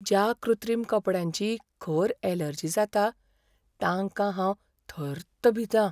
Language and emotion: Goan Konkani, fearful